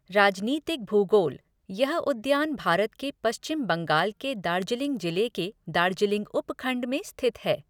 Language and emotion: Hindi, neutral